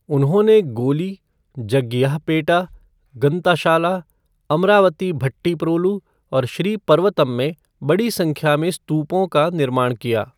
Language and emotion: Hindi, neutral